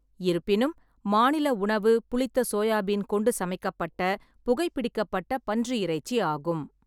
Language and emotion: Tamil, neutral